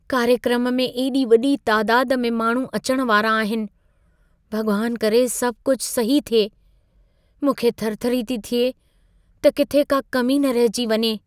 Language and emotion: Sindhi, fearful